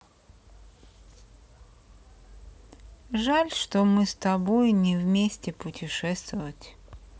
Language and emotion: Russian, sad